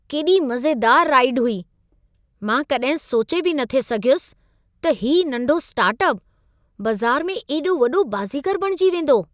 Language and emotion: Sindhi, surprised